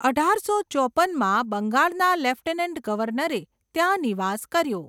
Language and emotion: Gujarati, neutral